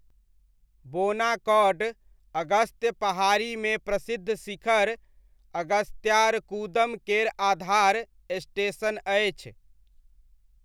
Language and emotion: Maithili, neutral